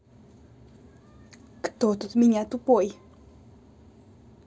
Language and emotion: Russian, angry